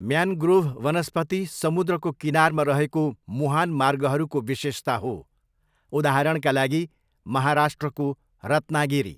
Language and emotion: Nepali, neutral